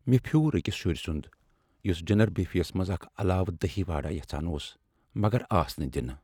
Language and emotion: Kashmiri, sad